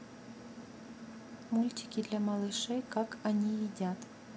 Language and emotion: Russian, neutral